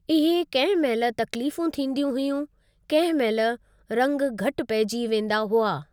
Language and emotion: Sindhi, neutral